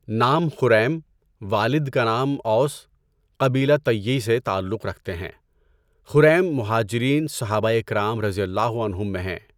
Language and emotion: Urdu, neutral